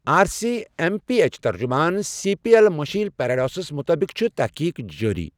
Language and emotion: Kashmiri, neutral